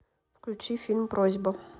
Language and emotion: Russian, neutral